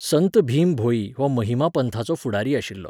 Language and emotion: Goan Konkani, neutral